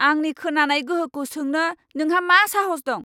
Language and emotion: Bodo, angry